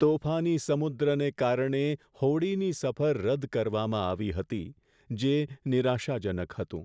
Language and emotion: Gujarati, sad